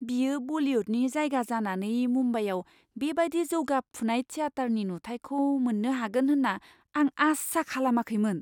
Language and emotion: Bodo, surprised